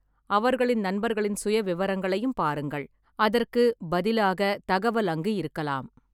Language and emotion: Tamil, neutral